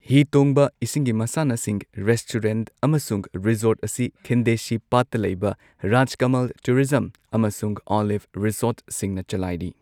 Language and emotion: Manipuri, neutral